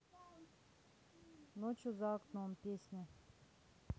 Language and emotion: Russian, neutral